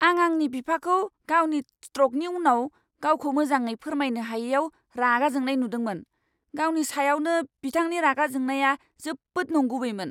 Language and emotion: Bodo, angry